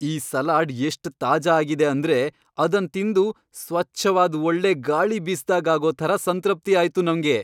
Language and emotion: Kannada, happy